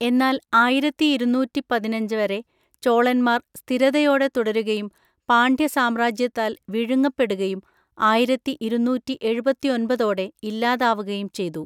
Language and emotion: Malayalam, neutral